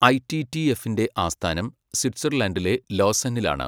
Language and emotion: Malayalam, neutral